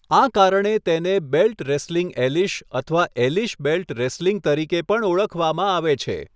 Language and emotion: Gujarati, neutral